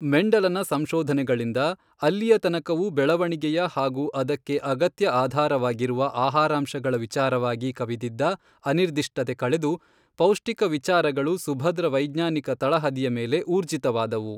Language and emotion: Kannada, neutral